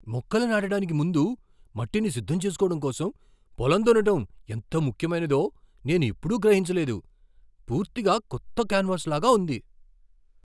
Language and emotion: Telugu, surprised